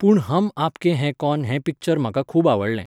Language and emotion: Goan Konkani, neutral